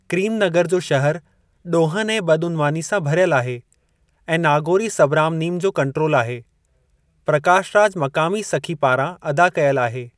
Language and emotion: Sindhi, neutral